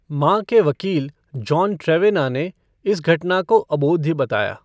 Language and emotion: Hindi, neutral